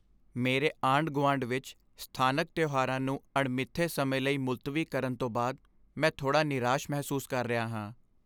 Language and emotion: Punjabi, sad